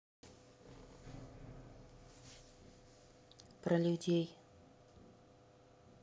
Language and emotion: Russian, neutral